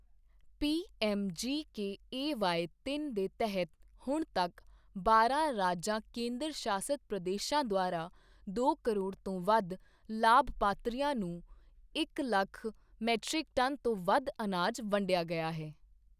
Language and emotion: Punjabi, neutral